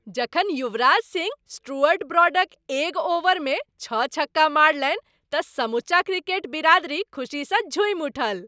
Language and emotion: Maithili, happy